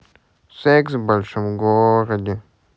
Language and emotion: Russian, sad